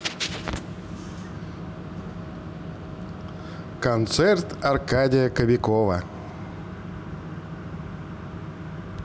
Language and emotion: Russian, positive